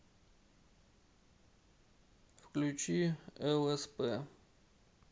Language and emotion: Russian, neutral